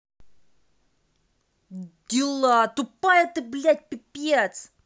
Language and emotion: Russian, angry